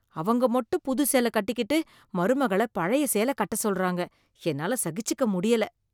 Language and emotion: Tamil, disgusted